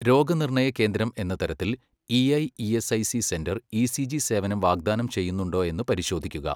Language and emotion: Malayalam, neutral